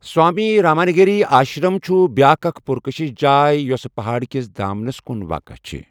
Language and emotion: Kashmiri, neutral